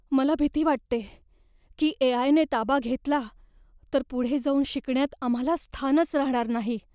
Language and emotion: Marathi, fearful